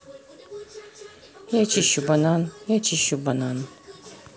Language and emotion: Russian, neutral